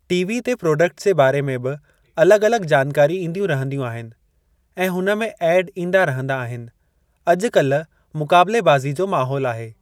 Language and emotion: Sindhi, neutral